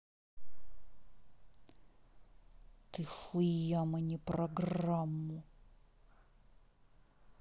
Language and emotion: Russian, angry